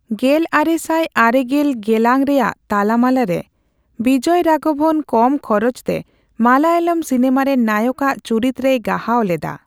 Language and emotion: Santali, neutral